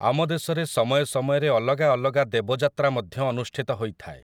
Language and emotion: Odia, neutral